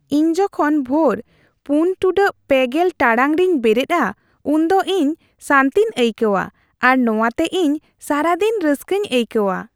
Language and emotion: Santali, happy